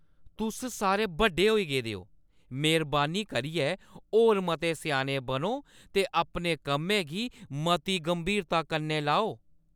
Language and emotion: Dogri, angry